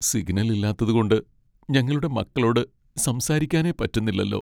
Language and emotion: Malayalam, sad